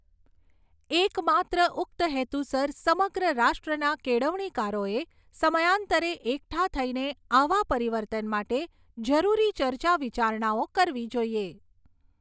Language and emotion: Gujarati, neutral